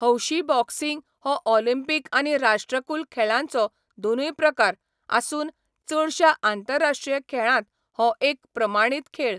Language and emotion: Goan Konkani, neutral